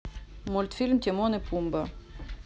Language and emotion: Russian, neutral